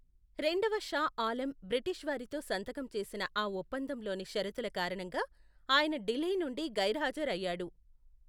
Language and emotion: Telugu, neutral